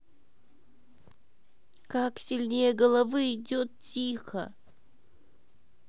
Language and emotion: Russian, sad